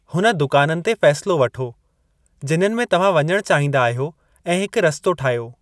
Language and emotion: Sindhi, neutral